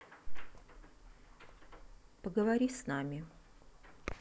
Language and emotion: Russian, neutral